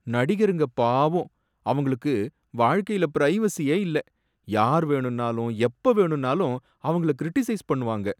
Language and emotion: Tamil, sad